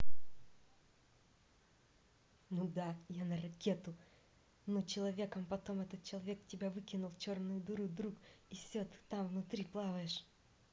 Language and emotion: Russian, neutral